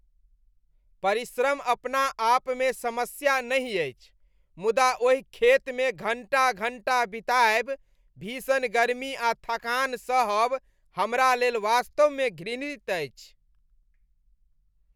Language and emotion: Maithili, disgusted